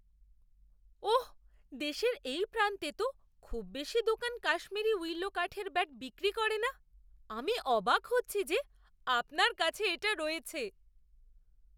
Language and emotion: Bengali, surprised